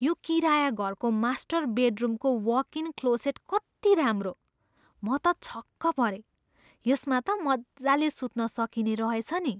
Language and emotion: Nepali, surprised